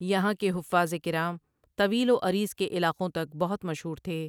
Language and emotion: Urdu, neutral